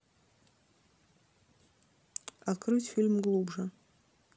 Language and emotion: Russian, neutral